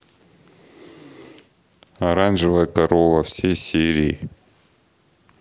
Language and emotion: Russian, neutral